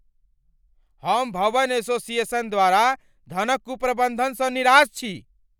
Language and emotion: Maithili, angry